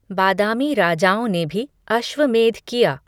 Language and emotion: Hindi, neutral